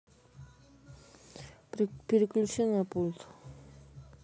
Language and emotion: Russian, neutral